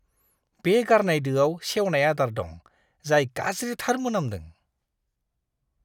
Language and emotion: Bodo, disgusted